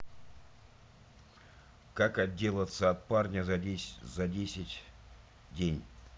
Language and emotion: Russian, neutral